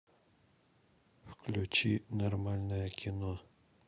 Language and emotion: Russian, neutral